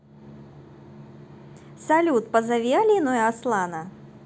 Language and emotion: Russian, positive